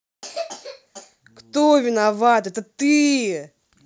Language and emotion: Russian, angry